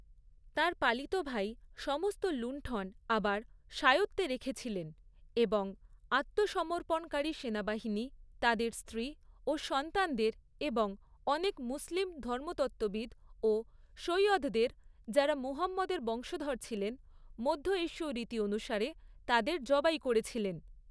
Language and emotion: Bengali, neutral